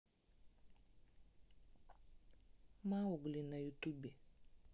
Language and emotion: Russian, neutral